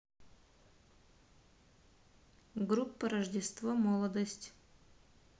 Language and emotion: Russian, neutral